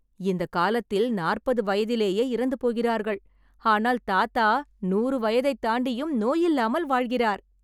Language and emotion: Tamil, happy